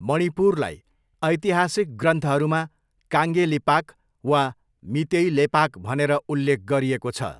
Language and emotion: Nepali, neutral